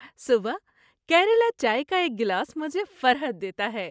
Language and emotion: Urdu, happy